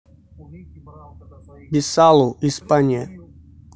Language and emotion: Russian, neutral